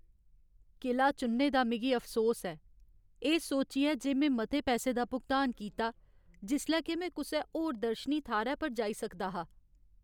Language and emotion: Dogri, sad